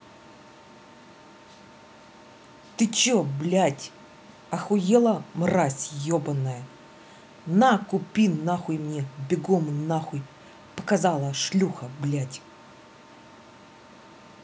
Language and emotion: Russian, angry